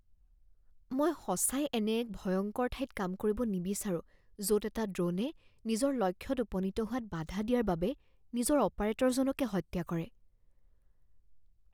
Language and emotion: Assamese, fearful